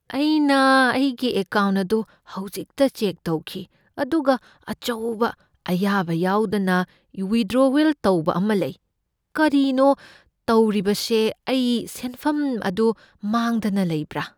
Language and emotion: Manipuri, fearful